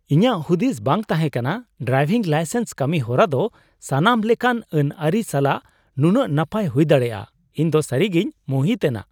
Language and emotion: Santali, surprised